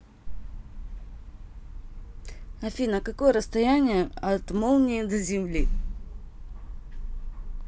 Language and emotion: Russian, neutral